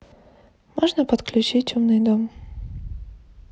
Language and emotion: Russian, neutral